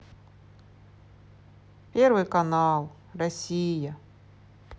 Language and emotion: Russian, sad